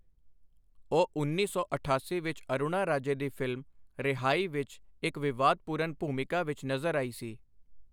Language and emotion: Punjabi, neutral